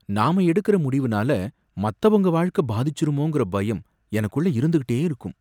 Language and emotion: Tamil, fearful